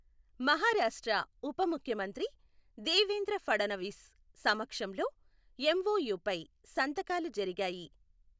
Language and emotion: Telugu, neutral